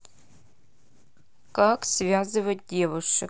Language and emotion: Russian, neutral